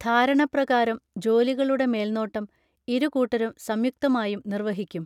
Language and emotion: Malayalam, neutral